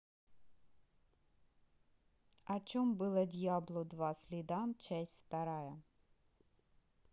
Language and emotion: Russian, neutral